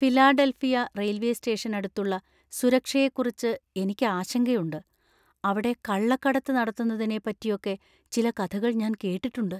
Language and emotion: Malayalam, fearful